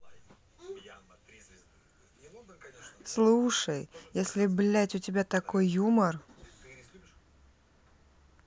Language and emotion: Russian, angry